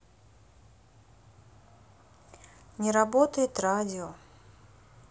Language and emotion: Russian, sad